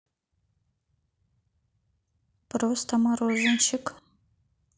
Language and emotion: Russian, neutral